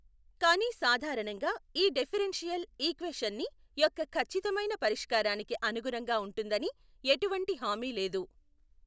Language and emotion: Telugu, neutral